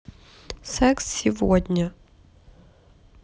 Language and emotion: Russian, neutral